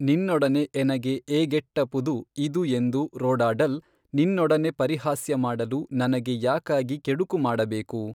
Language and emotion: Kannada, neutral